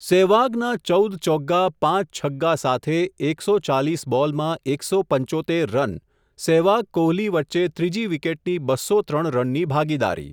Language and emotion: Gujarati, neutral